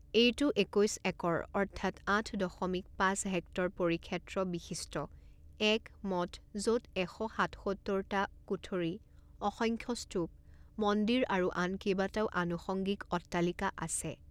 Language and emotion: Assamese, neutral